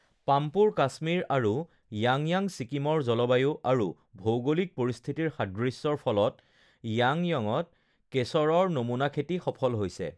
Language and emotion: Assamese, neutral